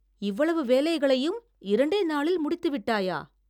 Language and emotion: Tamil, surprised